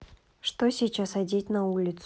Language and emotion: Russian, neutral